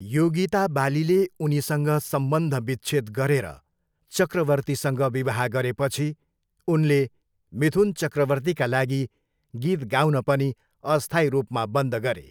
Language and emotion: Nepali, neutral